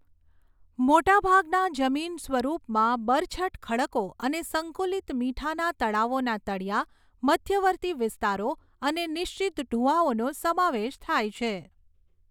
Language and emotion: Gujarati, neutral